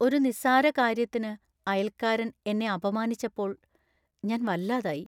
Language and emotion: Malayalam, sad